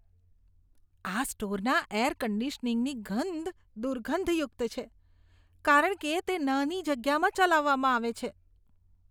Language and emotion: Gujarati, disgusted